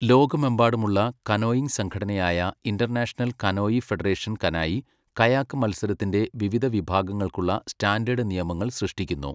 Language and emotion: Malayalam, neutral